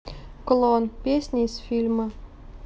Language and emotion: Russian, neutral